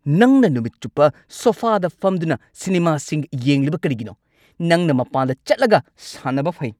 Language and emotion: Manipuri, angry